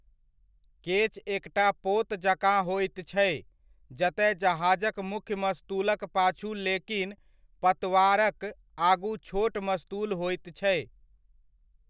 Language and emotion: Maithili, neutral